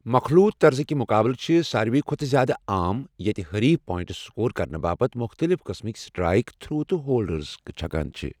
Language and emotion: Kashmiri, neutral